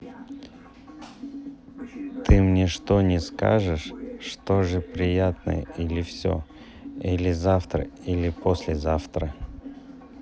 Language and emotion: Russian, neutral